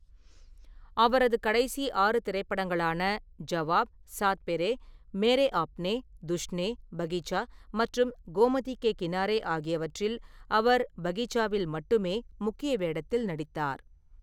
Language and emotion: Tamil, neutral